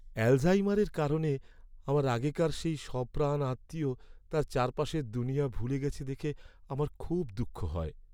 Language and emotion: Bengali, sad